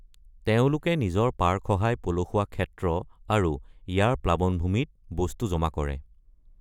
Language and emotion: Assamese, neutral